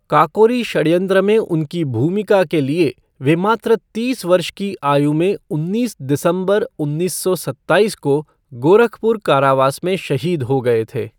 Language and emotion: Hindi, neutral